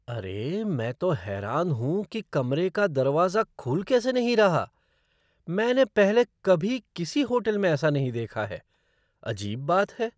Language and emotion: Hindi, surprised